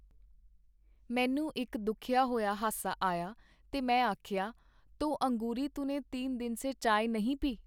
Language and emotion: Punjabi, neutral